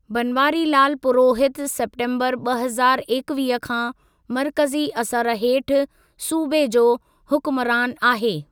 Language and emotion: Sindhi, neutral